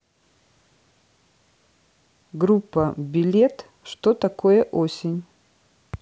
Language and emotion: Russian, neutral